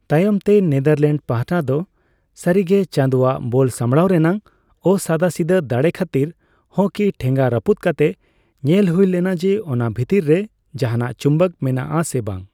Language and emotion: Santali, neutral